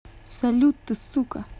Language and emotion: Russian, angry